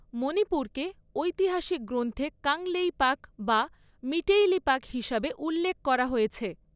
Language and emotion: Bengali, neutral